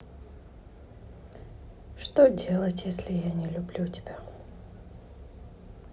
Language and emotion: Russian, sad